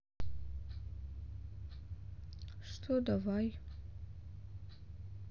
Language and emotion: Russian, neutral